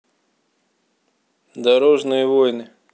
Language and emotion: Russian, neutral